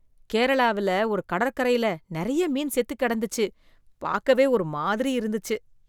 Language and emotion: Tamil, disgusted